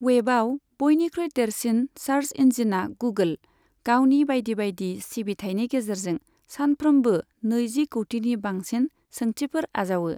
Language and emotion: Bodo, neutral